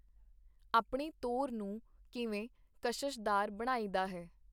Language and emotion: Punjabi, neutral